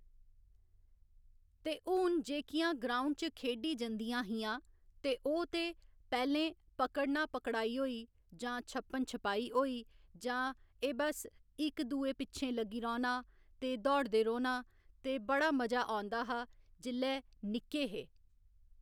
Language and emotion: Dogri, neutral